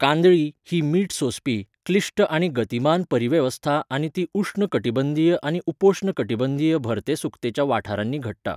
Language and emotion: Goan Konkani, neutral